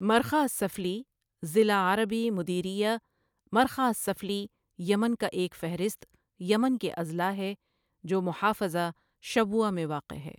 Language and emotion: Urdu, neutral